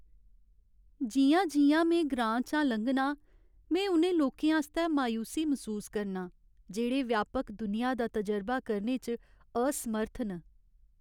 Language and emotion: Dogri, sad